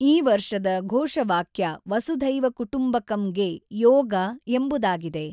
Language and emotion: Kannada, neutral